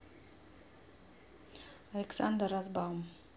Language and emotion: Russian, neutral